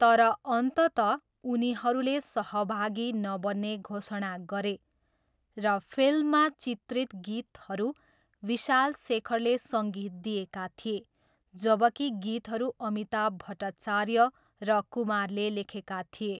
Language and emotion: Nepali, neutral